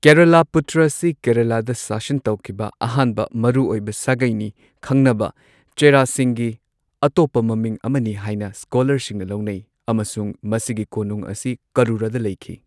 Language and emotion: Manipuri, neutral